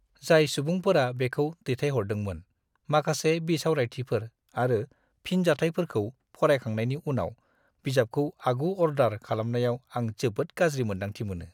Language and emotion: Bodo, disgusted